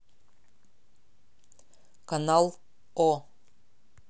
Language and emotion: Russian, neutral